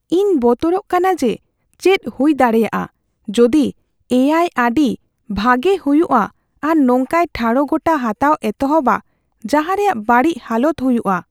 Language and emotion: Santali, fearful